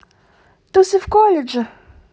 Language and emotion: Russian, neutral